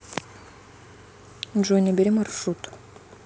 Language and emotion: Russian, neutral